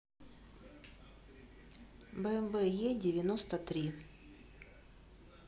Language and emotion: Russian, neutral